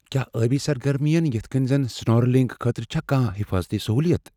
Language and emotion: Kashmiri, fearful